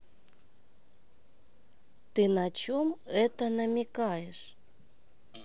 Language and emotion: Russian, neutral